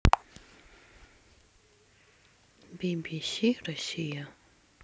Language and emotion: Russian, sad